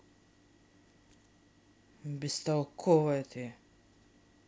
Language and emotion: Russian, angry